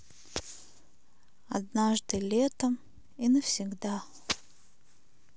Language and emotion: Russian, sad